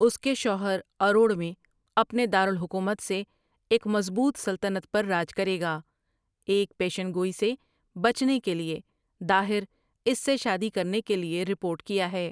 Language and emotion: Urdu, neutral